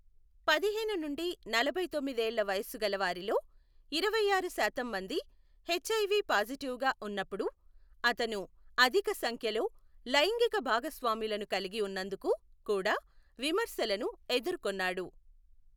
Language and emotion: Telugu, neutral